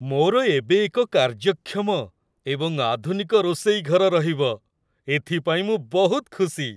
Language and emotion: Odia, happy